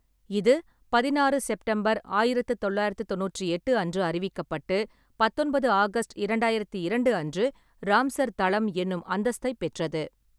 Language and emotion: Tamil, neutral